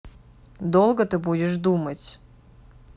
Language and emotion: Russian, angry